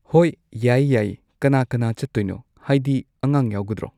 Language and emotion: Manipuri, neutral